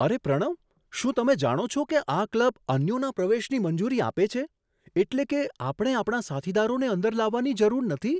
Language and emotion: Gujarati, surprised